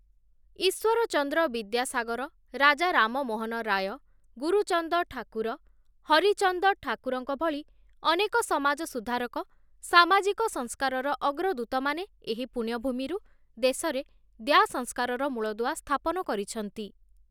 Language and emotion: Odia, neutral